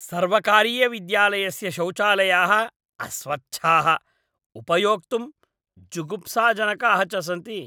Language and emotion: Sanskrit, disgusted